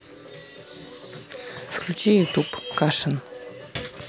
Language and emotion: Russian, neutral